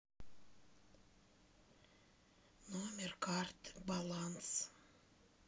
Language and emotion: Russian, sad